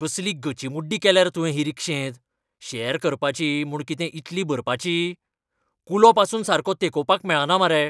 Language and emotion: Goan Konkani, angry